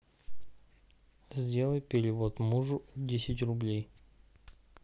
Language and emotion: Russian, neutral